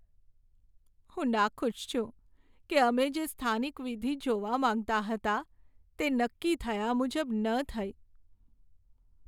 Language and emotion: Gujarati, sad